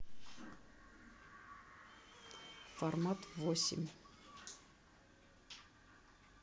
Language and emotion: Russian, neutral